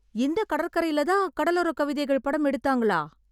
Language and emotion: Tamil, surprised